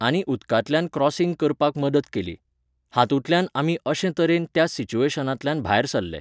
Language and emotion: Goan Konkani, neutral